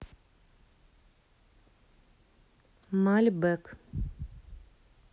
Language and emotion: Russian, neutral